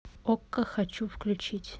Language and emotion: Russian, neutral